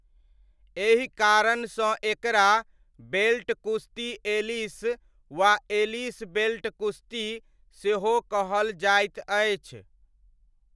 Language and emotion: Maithili, neutral